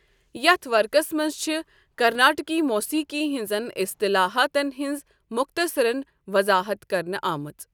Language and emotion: Kashmiri, neutral